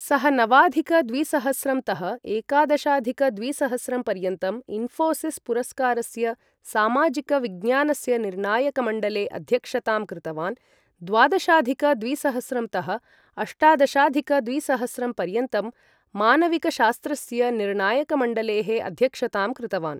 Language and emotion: Sanskrit, neutral